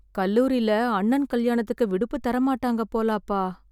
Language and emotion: Tamil, sad